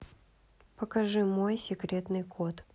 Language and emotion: Russian, neutral